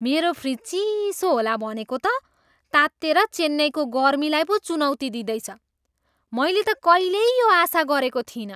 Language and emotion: Nepali, surprised